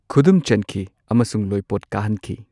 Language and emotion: Manipuri, neutral